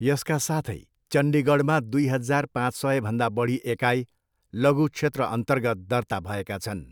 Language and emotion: Nepali, neutral